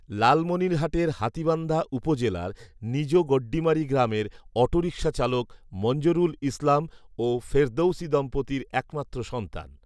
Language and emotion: Bengali, neutral